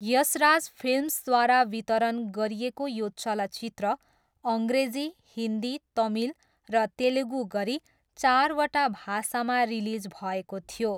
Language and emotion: Nepali, neutral